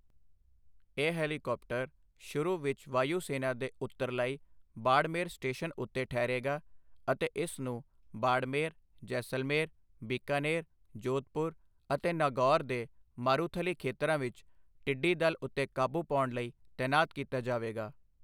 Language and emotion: Punjabi, neutral